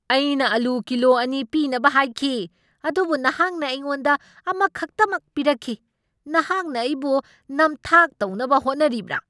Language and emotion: Manipuri, angry